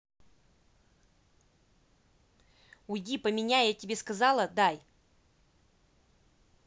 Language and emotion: Russian, angry